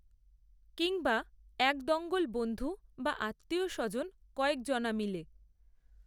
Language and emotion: Bengali, neutral